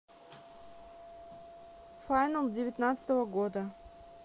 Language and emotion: Russian, neutral